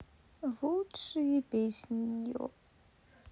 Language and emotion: Russian, sad